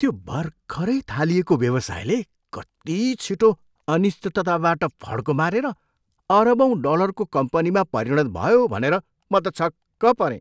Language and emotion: Nepali, surprised